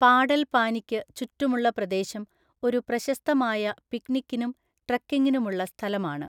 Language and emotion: Malayalam, neutral